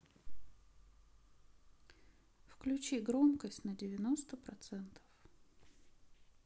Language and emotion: Russian, neutral